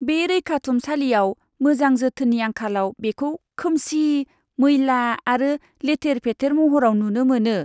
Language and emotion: Bodo, disgusted